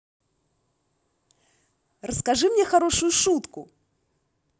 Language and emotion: Russian, positive